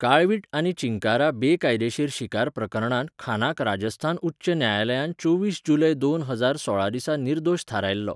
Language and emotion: Goan Konkani, neutral